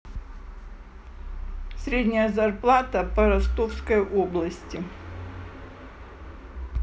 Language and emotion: Russian, neutral